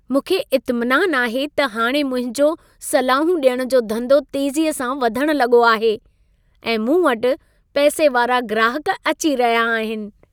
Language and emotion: Sindhi, happy